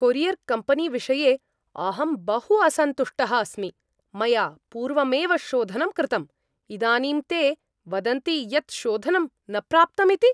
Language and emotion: Sanskrit, angry